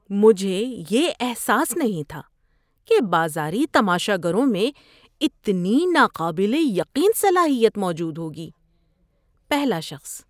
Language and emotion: Urdu, surprised